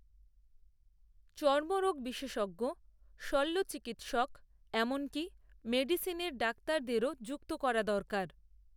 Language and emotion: Bengali, neutral